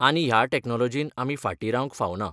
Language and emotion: Goan Konkani, neutral